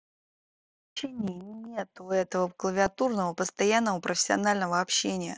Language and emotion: Russian, angry